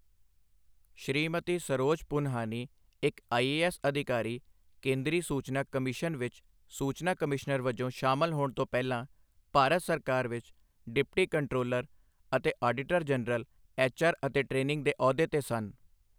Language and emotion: Punjabi, neutral